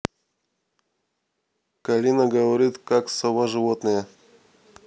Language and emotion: Russian, neutral